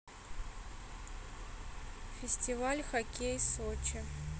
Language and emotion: Russian, neutral